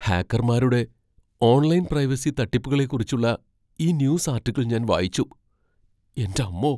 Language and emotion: Malayalam, fearful